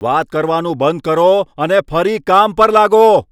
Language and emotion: Gujarati, angry